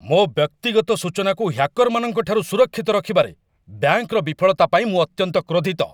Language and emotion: Odia, angry